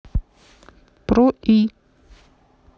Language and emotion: Russian, neutral